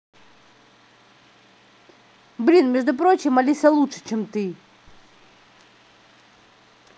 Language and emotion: Russian, angry